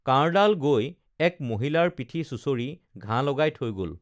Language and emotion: Assamese, neutral